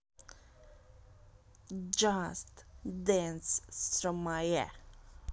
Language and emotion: Russian, positive